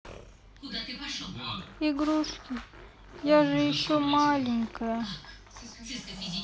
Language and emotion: Russian, sad